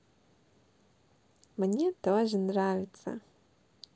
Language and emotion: Russian, positive